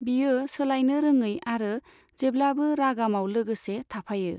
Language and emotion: Bodo, neutral